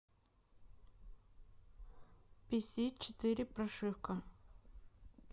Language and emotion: Russian, neutral